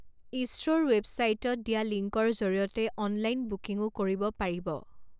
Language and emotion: Assamese, neutral